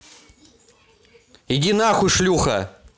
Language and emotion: Russian, angry